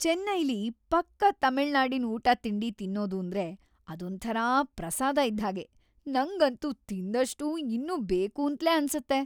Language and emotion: Kannada, happy